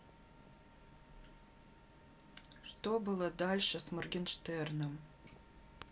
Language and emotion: Russian, neutral